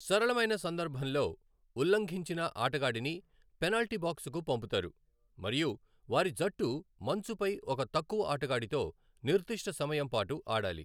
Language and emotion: Telugu, neutral